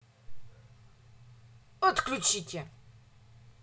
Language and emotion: Russian, angry